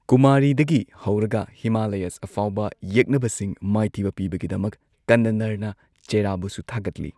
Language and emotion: Manipuri, neutral